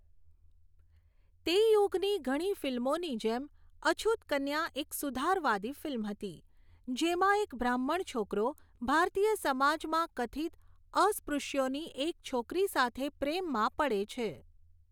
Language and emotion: Gujarati, neutral